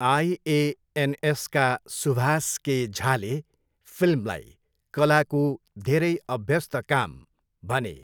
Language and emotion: Nepali, neutral